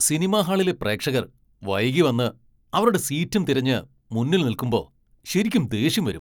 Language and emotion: Malayalam, angry